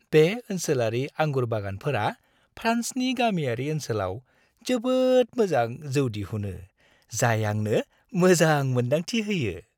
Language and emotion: Bodo, happy